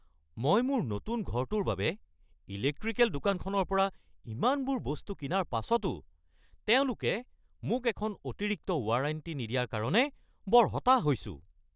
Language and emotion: Assamese, angry